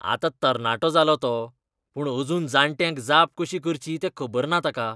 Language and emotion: Goan Konkani, disgusted